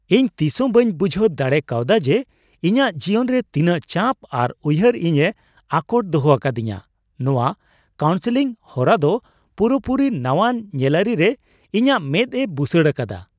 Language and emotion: Santali, surprised